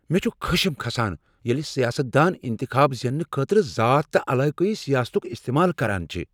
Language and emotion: Kashmiri, angry